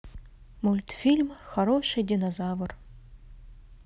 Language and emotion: Russian, neutral